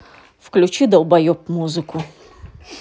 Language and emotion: Russian, angry